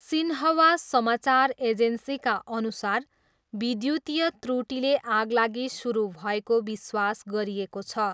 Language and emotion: Nepali, neutral